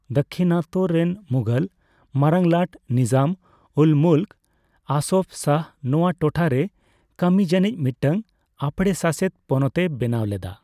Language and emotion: Santali, neutral